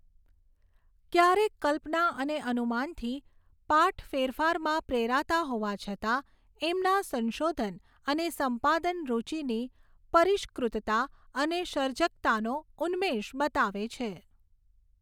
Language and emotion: Gujarati, neutral